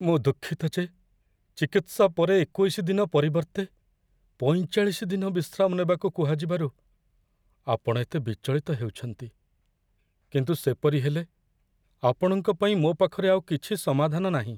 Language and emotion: Odia, sad